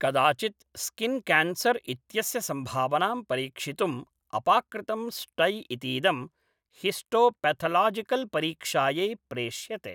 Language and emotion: Sanskrit, neutral